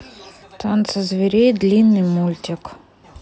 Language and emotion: Russian, neutral